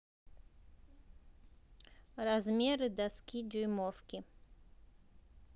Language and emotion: Russian, neutral